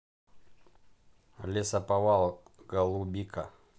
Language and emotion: Russian, neutral